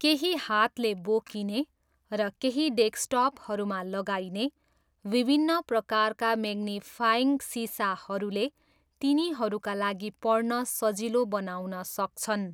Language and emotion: Nepali, neutral